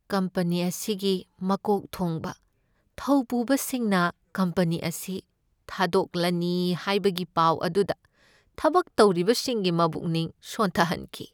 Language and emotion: Manipuri, sad